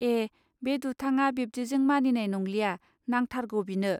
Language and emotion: Bodo, neutral